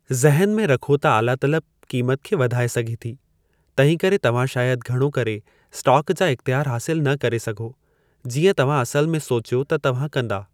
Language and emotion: Sindhi, neutral